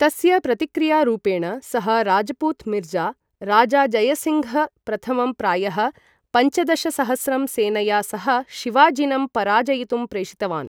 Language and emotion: Sanskrit, neutral